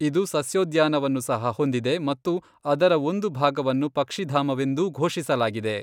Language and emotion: Kannada, neutral